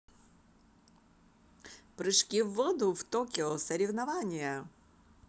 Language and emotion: Russian, positive